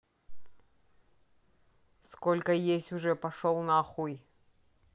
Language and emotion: Russian, angry